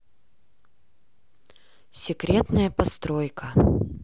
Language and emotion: Russian, neutral